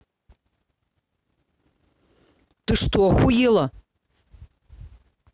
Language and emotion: Russian, angry